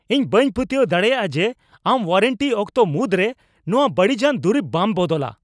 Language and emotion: Santali, angry